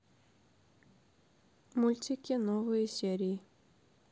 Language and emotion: Russian, neutral